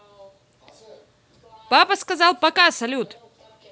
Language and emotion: Russian, positive